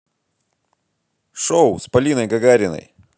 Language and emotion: Russian, positive